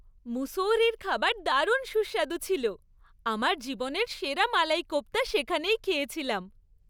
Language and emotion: Bengali, happy